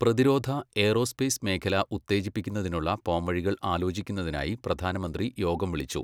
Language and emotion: Malayalam, neutral